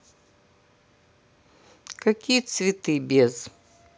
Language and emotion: Russian, neutral